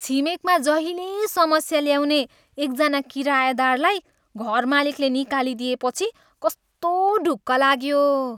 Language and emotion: Nepali, happy